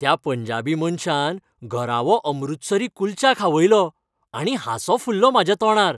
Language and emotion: Goan Konkani, happy